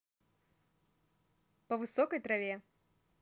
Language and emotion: Russian, neutral